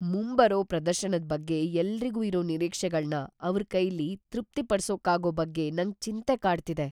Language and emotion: Kannada, fearful